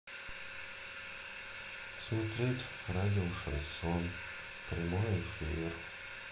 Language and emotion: Russian, sad